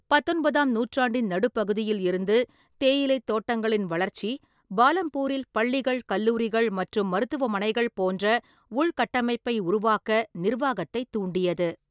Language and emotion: Tamil, neutral